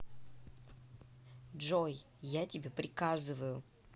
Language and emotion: Russian, angry